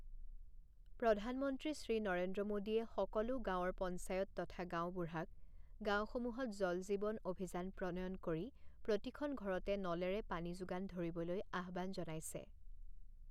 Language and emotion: Assamese, neutral